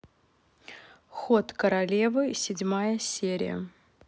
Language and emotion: Russian, neutral